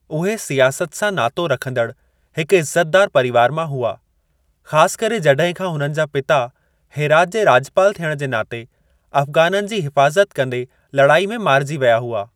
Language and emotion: Sindhi, neutral